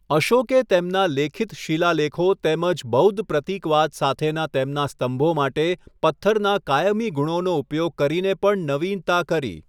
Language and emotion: Gujarati, neutral